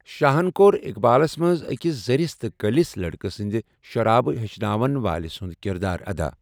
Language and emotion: Kashmiri, neutral